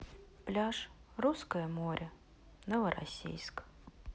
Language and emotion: Russian, sad